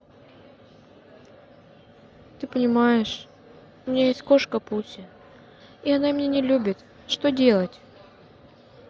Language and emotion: Russian, sad